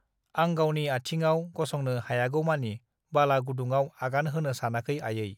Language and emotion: Bodo, neutral